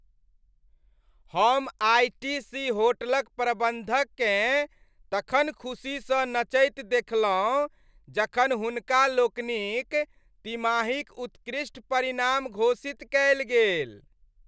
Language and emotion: Maithili, happy